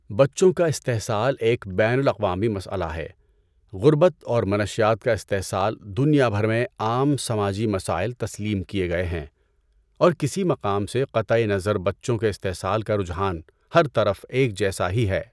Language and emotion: Urdu, neutral